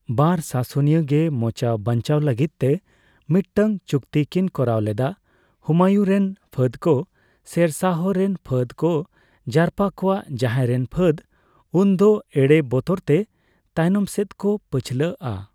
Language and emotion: Santali, neutral